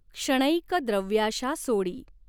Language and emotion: Marathi, neutral